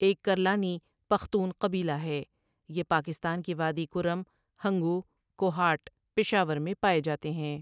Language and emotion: Urdu, neutral